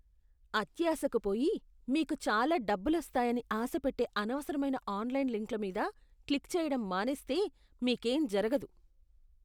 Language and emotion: Telugu, disgusted